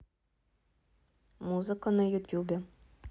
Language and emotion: Russian, neutral